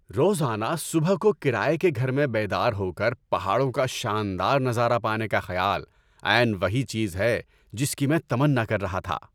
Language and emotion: Urdu, happy